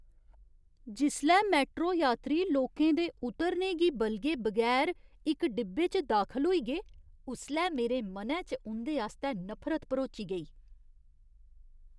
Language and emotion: Dogri, disgusted